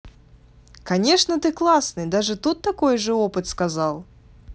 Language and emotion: Russian, positive